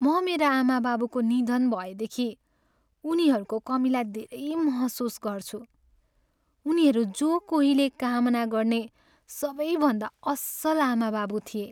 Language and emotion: Nepali, sad